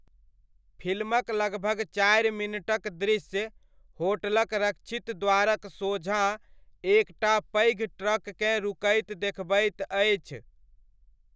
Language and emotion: Maithili, neutral